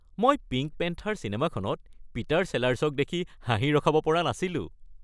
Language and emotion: Assamese, happy